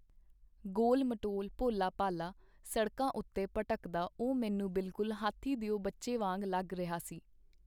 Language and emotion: Punjabi, neutral